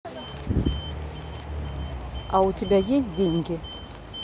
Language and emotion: Russian, neutral